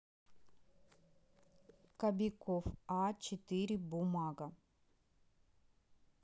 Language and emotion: Russian, neutral